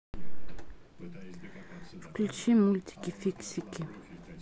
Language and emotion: Russian, neutral